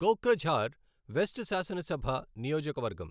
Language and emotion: Telugu, neutral